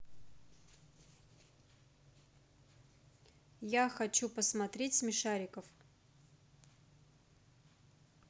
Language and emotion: Russian, neutral